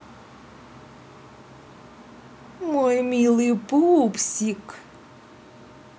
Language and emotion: Russian, positive